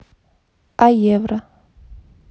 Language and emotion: Russian, neutral